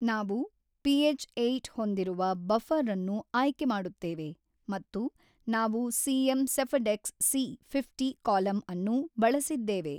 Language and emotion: Kannada, neutral